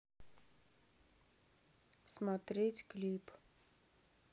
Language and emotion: Russian, neutral